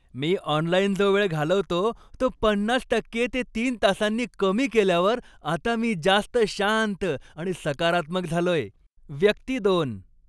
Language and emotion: Marathi, happy